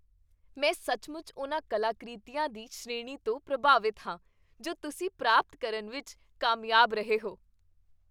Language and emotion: Punjabi, happy